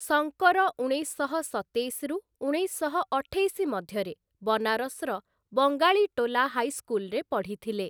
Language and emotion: Odia, neutral